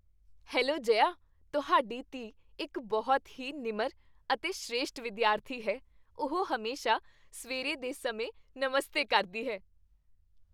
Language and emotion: Punjabi, happy